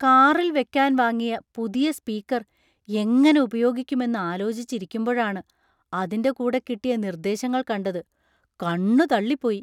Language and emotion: Malayalam, surprised